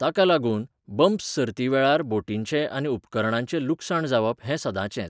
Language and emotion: Goan Konkani, neutral